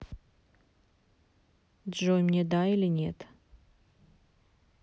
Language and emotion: Russian, neutral